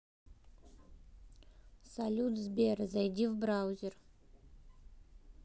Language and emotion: Russian, neutral